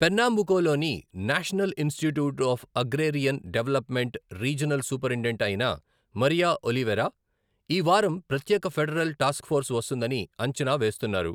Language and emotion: Telugu, neutral